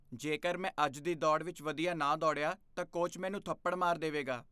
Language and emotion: Punjabi, fearful